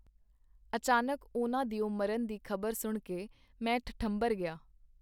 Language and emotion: Punjabi, neutral